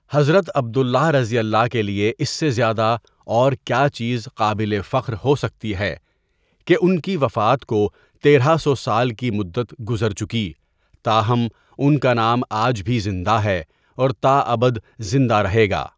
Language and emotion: Urdu, neutral